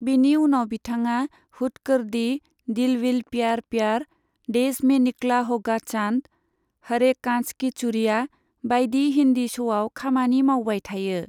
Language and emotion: Bodo, neutral